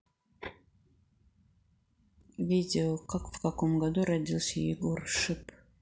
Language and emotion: Russian, neutral